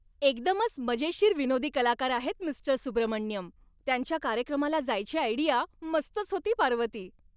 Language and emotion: Marathi, happy